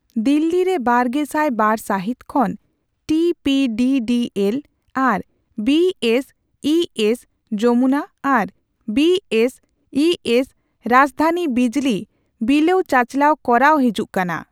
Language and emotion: Santali, neutral